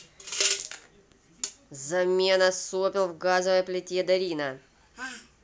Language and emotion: Russian, angry